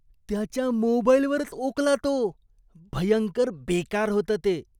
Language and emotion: Marathi, disgusted